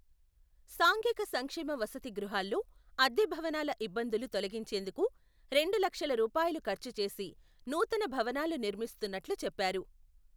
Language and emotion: Telugu, neutral